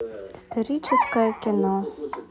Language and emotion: Russian, neutral